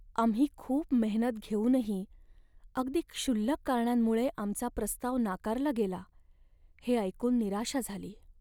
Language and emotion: Marathi, sad